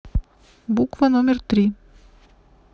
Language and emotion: Russian, neutral